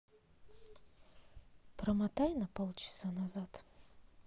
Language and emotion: Russian, neutral